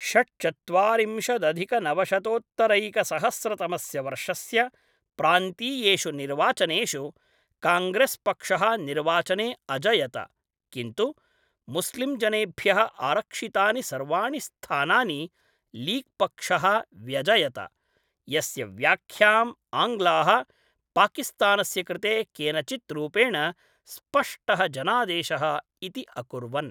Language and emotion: Sanskrit, neutral